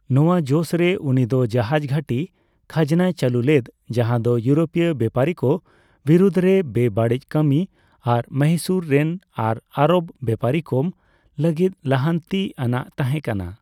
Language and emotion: Santali, neutral